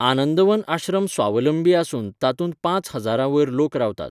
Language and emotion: Goan Konkani, neutral